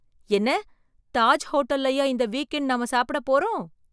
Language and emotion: Tamil, surprised